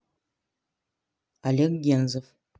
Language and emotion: Russian, neutral